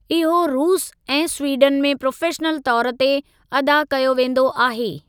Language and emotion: Sindhi, neutral